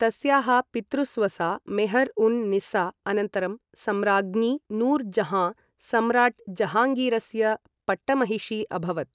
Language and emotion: Sanskrit, neutral